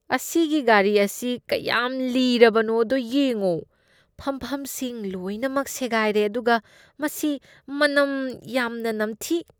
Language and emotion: Manipuri, disgusted